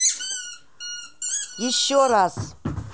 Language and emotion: Russian, angry